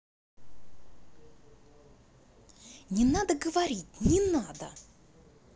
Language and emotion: Russian, angry